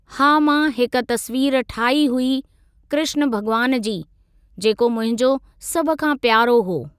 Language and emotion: Sindhi, neutral